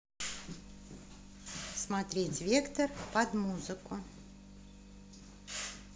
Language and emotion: Russian, positive